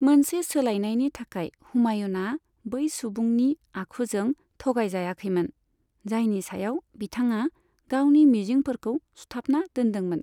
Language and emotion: Bodo, neutral